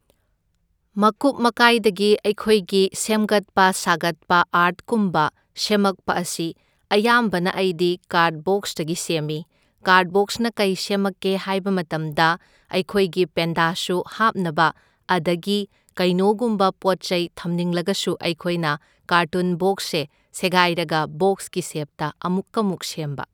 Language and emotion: Manipuri, neutral